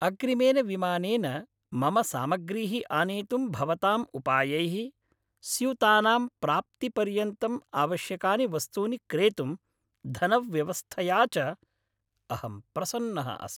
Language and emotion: Sanskrit, happy